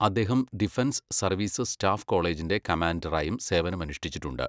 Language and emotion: Malayalam, neutral